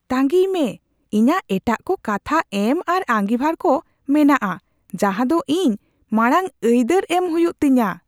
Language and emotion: Santali, surprised